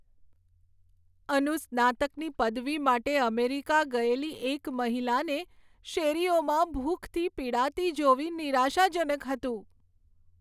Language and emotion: Gujarati, sad